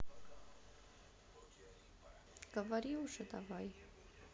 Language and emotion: Russian, sad